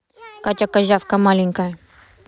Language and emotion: Russian, neutral